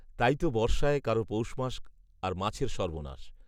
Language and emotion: Bengali, neutral